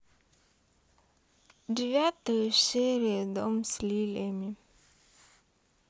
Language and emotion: Russian, sad